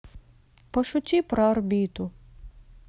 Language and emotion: Russian, sad